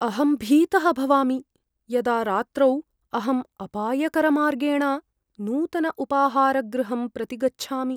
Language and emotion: Sanskrit, fearful